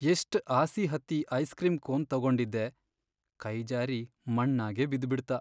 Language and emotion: Kannada, sad